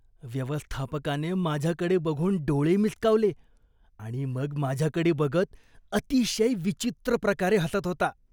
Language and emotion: Marathi, disgusted